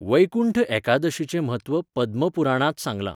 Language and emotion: Goan Konkani, neutral